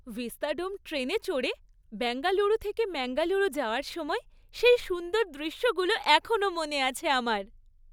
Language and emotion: Bengali, happy